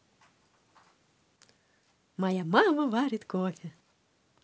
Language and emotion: Russian, positive